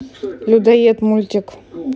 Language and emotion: Russian, neutral